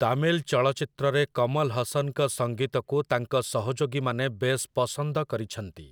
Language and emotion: Odia, neutral